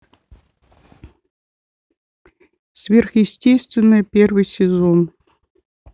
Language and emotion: Russian, neutral